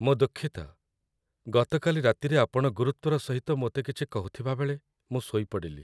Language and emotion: Odia, sad